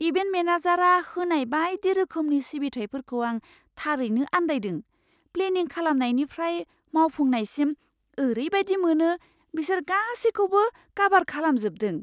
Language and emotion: Bodo, surprised